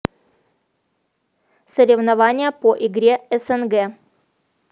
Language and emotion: Russian, neutral